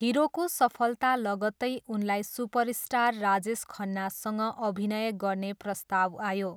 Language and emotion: Nepali, neutral